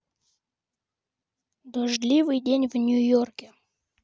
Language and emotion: Russian, neutral